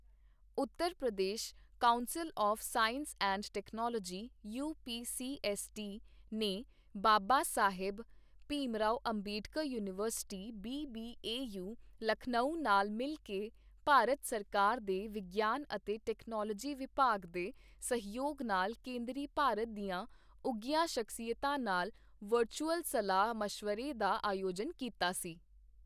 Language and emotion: Punjabi, neutral